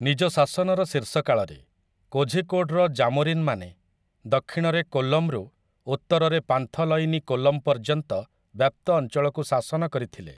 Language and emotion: Odia, neutral